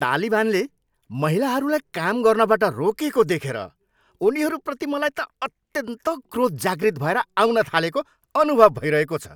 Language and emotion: Nepali, angry